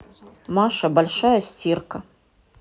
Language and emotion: Russian, neutral